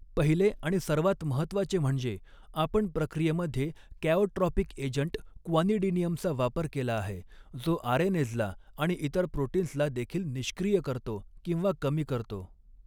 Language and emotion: Marathi, neutral